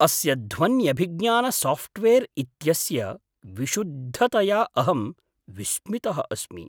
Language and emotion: Sanskrit, surprised